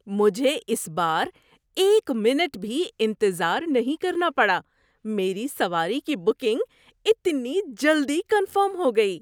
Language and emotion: Urdu, surprised